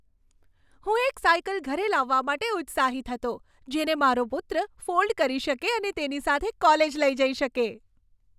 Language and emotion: Gujarati, happy